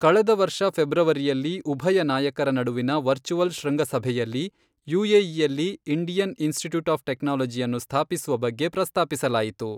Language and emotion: Kannada, neutral